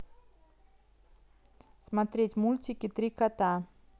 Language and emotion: Russian, neutral